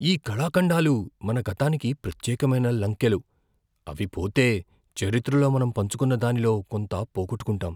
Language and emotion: Telugu, fearful